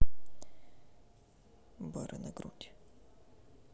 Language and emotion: Russian, neutral